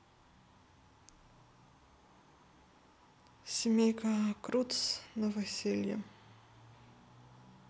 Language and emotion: Russian, sad